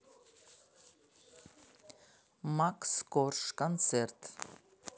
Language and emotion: Russian, neutral